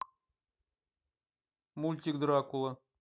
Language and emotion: Russian, neutral